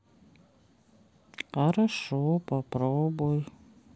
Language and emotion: Russian, sad